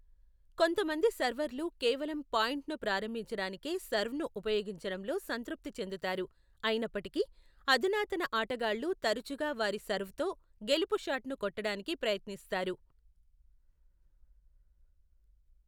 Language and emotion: Telugu, neutral